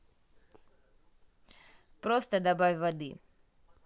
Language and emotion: Russian, neutral